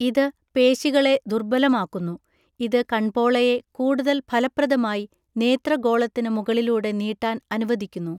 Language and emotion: Malayalam, neutral